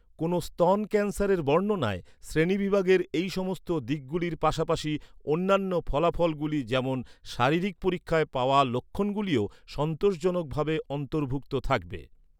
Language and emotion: Bengali, neutral